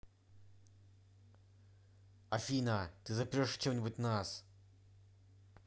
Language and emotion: Russian, angry